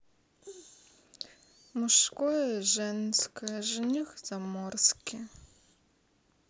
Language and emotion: Russian, sad